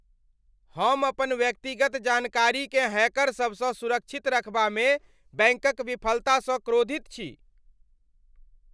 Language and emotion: Maithili, angry